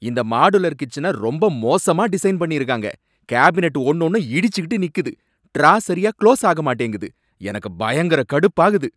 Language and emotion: Tamil, angry